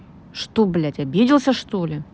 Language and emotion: Russian, angry